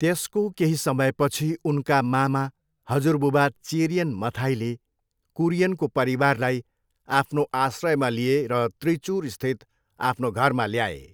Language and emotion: Nepali, neutral